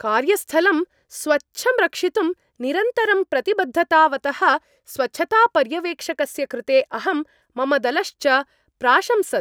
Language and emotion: Sanskrit, happy